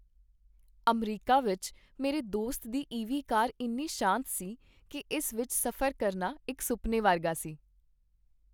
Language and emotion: Punjabi, happy